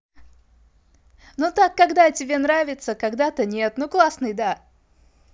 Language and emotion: Russian, positive